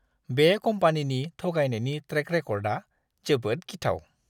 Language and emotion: Bodo, disgusted